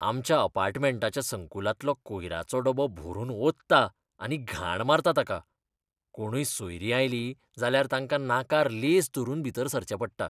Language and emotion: Goan Konkani, disgusted